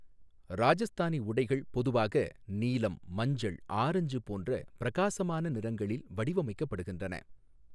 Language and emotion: Tamil, neutral